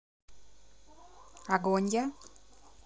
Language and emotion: Russian, neutral